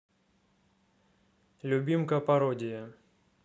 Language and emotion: Russian, neutral